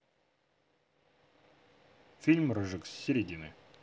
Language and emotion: Russian, neutral